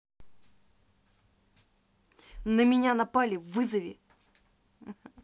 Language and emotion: Russian, angry